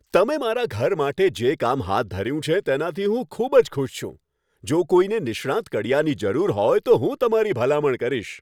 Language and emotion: Gujarati, happy